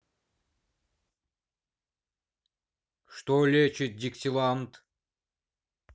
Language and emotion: Russian, neutral